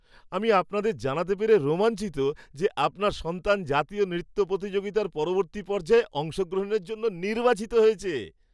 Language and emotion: Bengali, happy